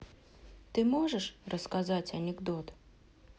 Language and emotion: Russian, neutral